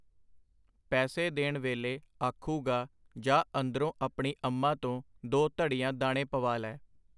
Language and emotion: Punjabi, neutral